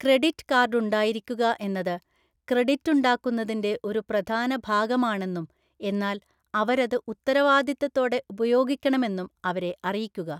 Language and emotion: Malayalam, neutral